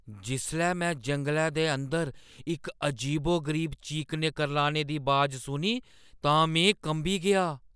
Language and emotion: Dogri, fearful